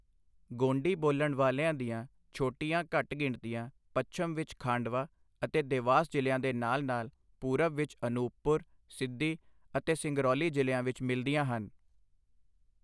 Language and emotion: Punjabi, neutral